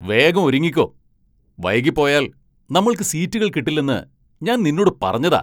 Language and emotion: Malayalam, angry